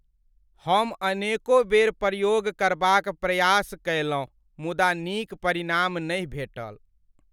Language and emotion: Maithili, sad